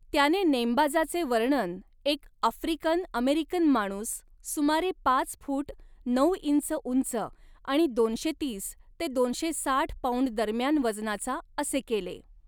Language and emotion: Marathi, neutral